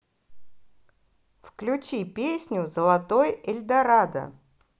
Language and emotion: Russian, positive